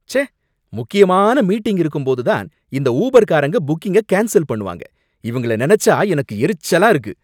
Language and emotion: Tamil, angry